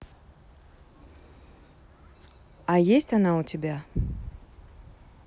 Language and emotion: Russian, neutral